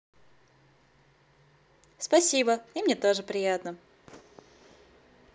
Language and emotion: Russian, positive